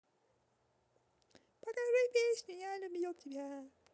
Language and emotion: Russian, positive